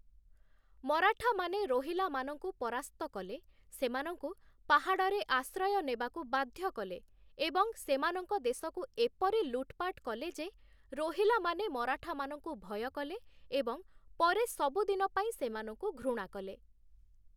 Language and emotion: Odia, neutral